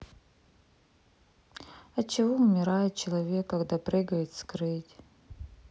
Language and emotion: Russian, sad